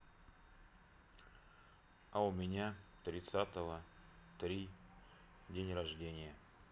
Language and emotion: Russian, neutral